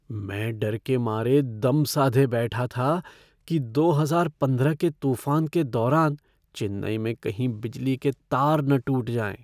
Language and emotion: Hindi, fearful